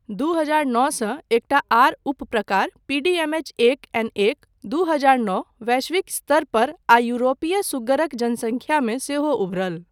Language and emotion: Maithili, neutral